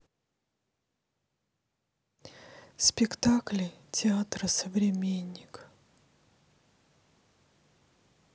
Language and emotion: Russian, sad